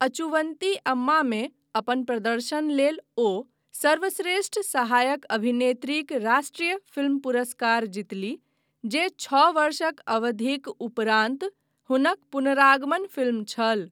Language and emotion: Maithili, neutral